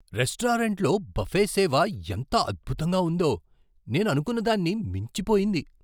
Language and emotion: Telugu, surprised